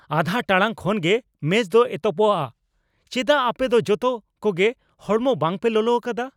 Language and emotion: Santali, angry